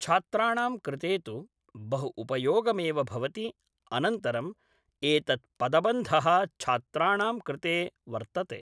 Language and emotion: Sanskrit, neutral